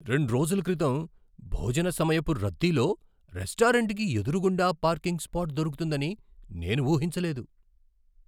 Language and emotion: Telugu, surprised